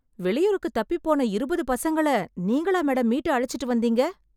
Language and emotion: Tamil, surprised